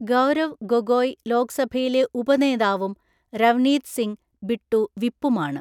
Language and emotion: Malayalam, neutral